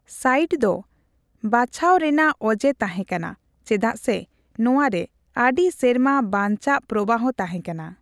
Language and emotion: Santali, neutral